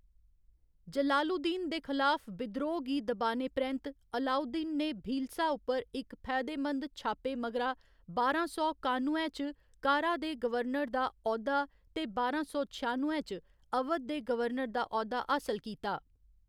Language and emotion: Dogri, neutral